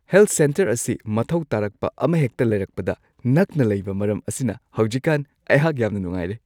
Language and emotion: Manipuri, happy